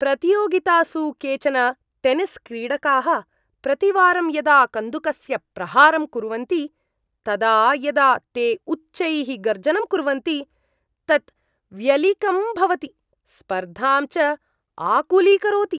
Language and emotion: Sanskrit, disgusted